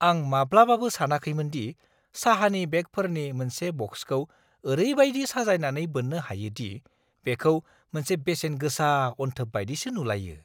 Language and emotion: Bodo, surprised